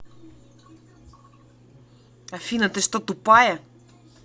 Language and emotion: Russian, angry